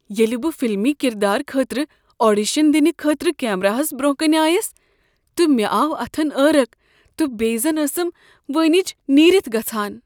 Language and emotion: Kashmiri, fearful